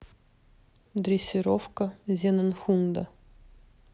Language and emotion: Russian, neutral